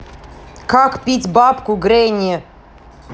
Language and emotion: Russian, angry